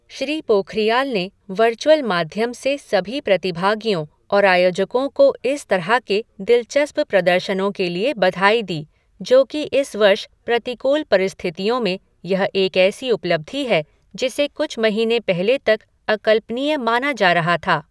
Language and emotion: Hindi, neutral